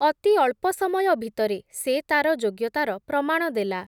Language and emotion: Odia, neutral